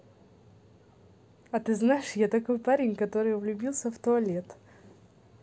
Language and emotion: Russian, positive